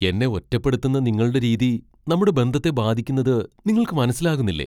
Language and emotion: Malayalam, surprised